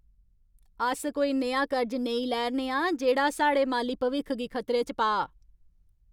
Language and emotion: Dogri, angry